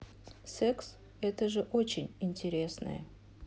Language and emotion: Russian, neutral